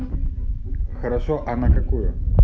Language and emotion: Russian, neutral